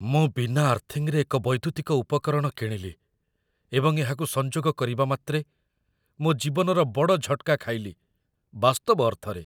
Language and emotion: Odia, fearful